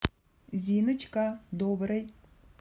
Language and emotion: Russian, positive